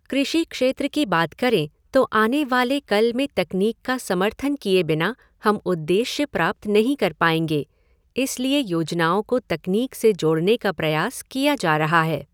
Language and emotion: Hindi, neutral